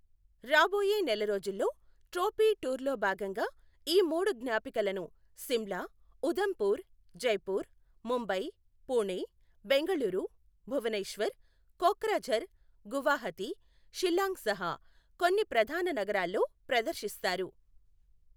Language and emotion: Telugu, neutral